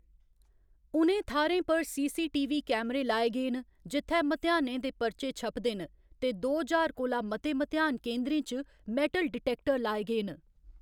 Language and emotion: Dogri, neutral